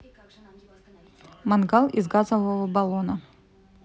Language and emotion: Russian, neutral